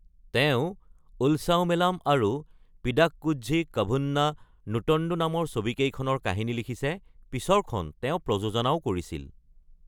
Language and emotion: Assamese, neutral